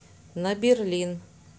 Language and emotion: Russian, neutral